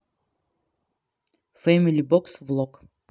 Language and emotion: Russian, neutral